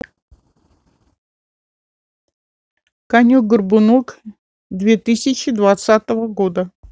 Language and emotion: Russian, neutral